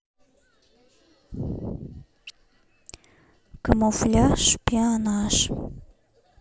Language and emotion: Russian, neutral